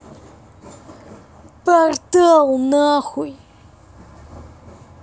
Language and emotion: Russian, angry